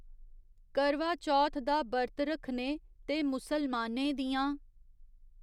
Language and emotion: Dogri, neutral